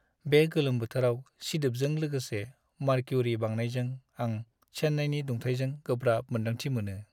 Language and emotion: Bodo, sad